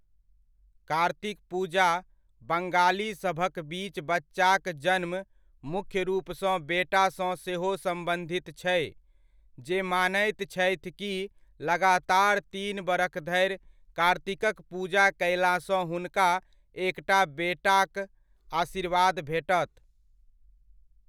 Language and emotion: Maithili, neutral